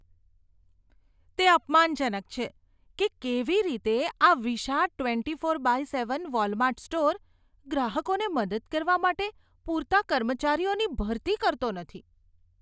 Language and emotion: Gujarati, disgusted